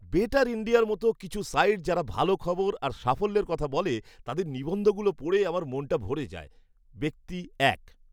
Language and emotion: Bengali, happy